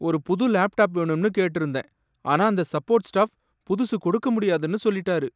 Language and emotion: Tamil, sad